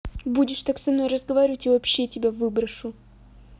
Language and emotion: Russian, angry